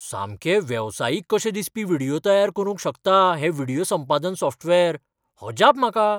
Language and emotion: Goan Konkani, surprised